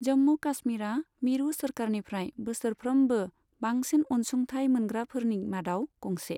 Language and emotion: Bodo, neutral